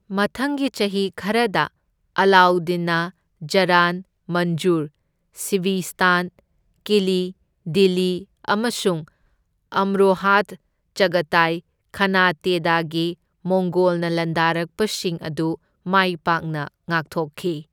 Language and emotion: Manipuri, neutral